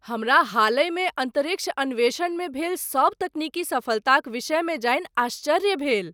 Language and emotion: Maithili, surprised